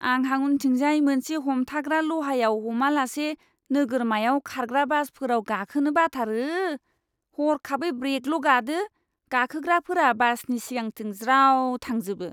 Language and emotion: Bodo, disgusted